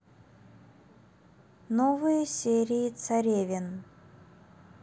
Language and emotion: Russian, neutral